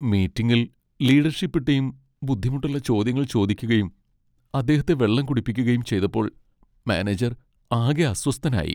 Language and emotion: Malayalam, sad